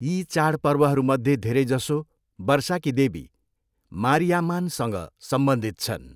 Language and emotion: Nepali, neutral